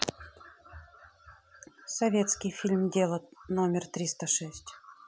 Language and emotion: Russian, neutral